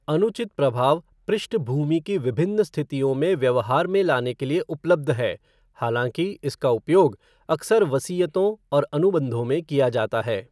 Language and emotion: Hindi, neutral